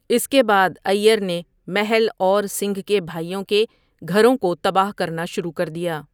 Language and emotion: Urdu, neutral